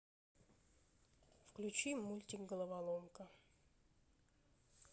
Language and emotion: Russian, neutral